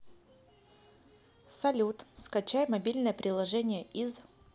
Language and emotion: Russian, neutral